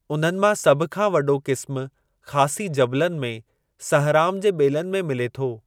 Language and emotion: Sindhi, neutral